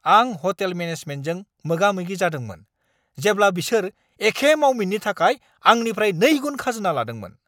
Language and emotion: Bodo, angry